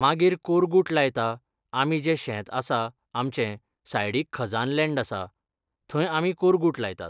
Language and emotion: Goan Konkani, neutral